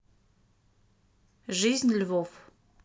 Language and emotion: Russian, neutral